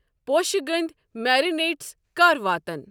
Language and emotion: Kashmiri, neutral